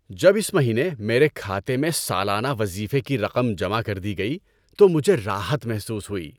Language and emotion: Urdu, happy